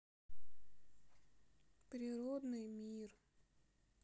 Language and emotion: Russian, sad